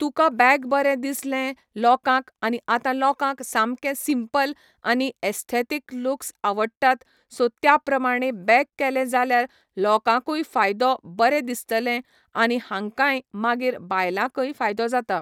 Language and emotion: Goan Konkani, neutral